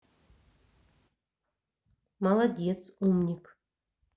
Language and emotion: Russian, neutral